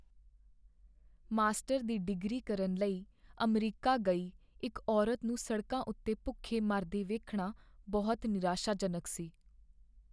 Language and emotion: Punjabi, sad